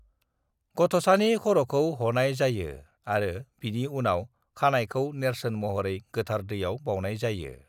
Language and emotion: Bodo, neutral